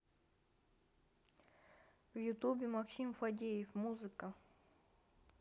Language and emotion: Russian, neutral